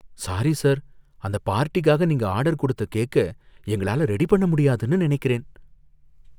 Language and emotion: Tamil, fearful